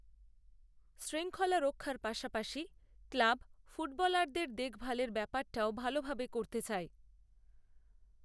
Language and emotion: Bengali, neutral